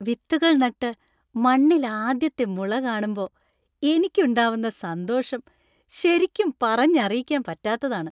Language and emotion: Malayalam, happy